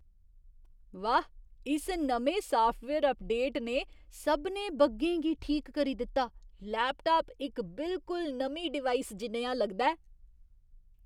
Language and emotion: Dogri, surprised